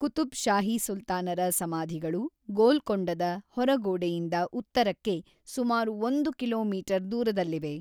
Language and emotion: Kannada, neutral